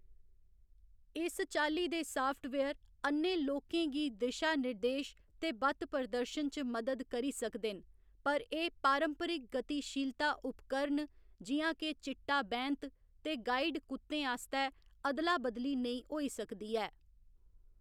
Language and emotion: Dogri, neutral